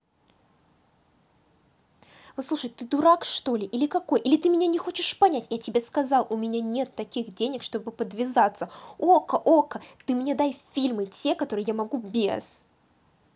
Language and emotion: Russian, angry